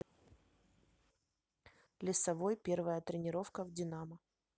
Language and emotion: Russian, neutral